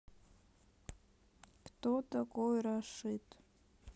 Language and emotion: Russian, sad